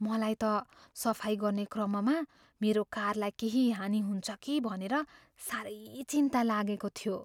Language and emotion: Nepali, fearful